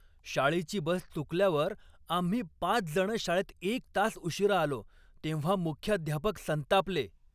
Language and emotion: Marathi, angry